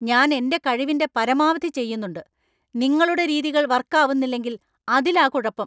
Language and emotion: Malayalam, angry